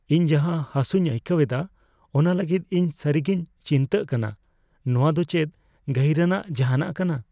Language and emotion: Santali, fearful